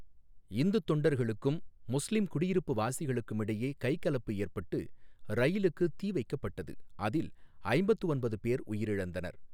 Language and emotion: Tamil, neutral